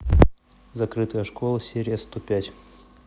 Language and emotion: Russian, neutral